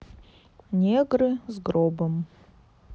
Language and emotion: Russian, neutral